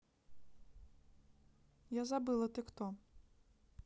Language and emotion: Russian, neutral